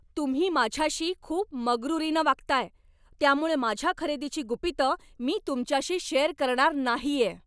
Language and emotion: Marathi, angry